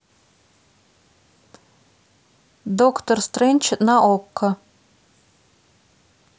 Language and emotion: Russian, neutral